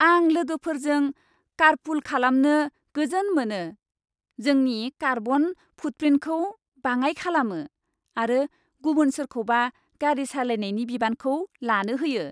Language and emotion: Bodo, happy